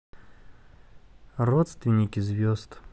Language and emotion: Russian, sad